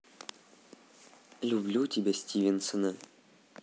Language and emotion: Russian, neutral